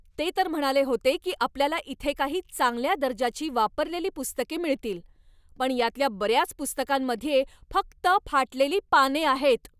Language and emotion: Marathi, angry